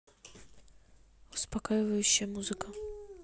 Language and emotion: Russian, neutral